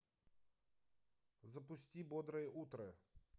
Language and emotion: Russian, neutral